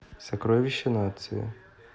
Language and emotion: Russian, neutral